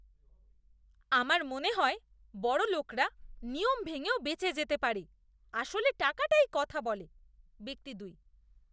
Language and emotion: Bengali, disgusted